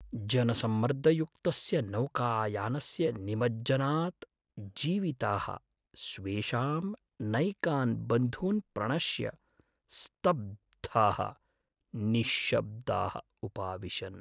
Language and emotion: Sanskrit, sad